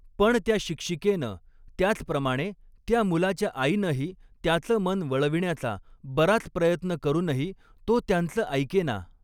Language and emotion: Marathi, neutral